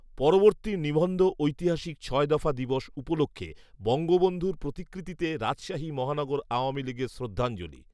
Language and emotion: Bengali, neutral